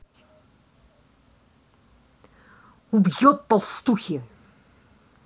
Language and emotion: Russian, angry